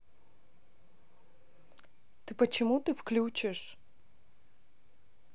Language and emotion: Russian, neutral